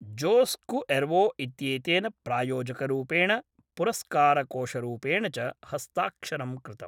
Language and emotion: Sanskrit, neutral